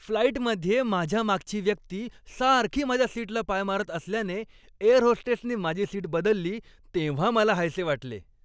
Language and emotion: Marathi, happy